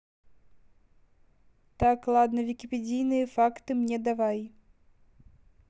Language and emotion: Russian, neutral